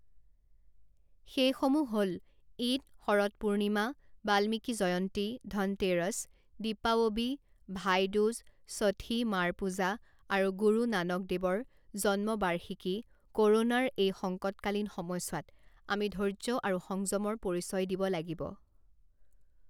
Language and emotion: Assamese, neutral